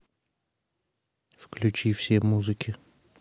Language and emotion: Russian, neutral